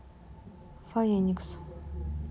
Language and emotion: Russian, sad